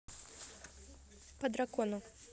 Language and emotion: Russian, neutral